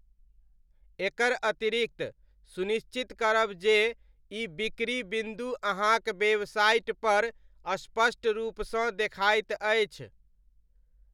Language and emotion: Maithili, neutral